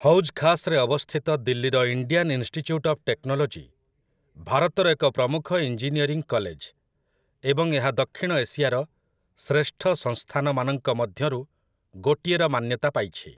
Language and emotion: Odia, neutral